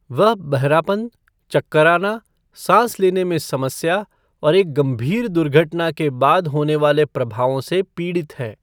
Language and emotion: Hindi, neutral